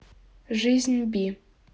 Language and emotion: Russian, neutral